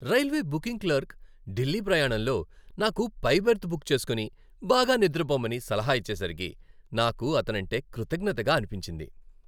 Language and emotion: Telugu, happy